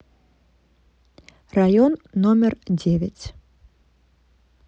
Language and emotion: Russian, neutral